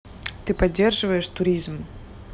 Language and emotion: Russian, neutral